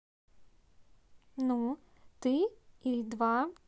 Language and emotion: Russian, neutral